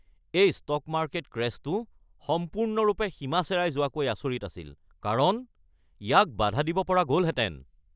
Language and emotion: Assamese, angry